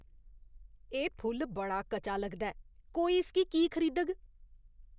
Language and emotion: Dogri, disgusted